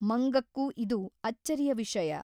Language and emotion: Kannada, neutral